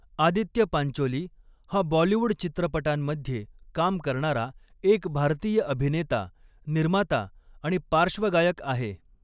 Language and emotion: Marathi, neutral